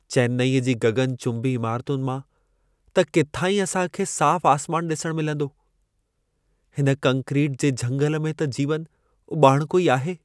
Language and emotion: Sindhi, sad